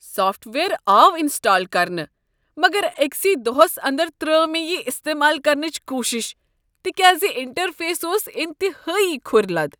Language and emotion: Kashmiri, disgusted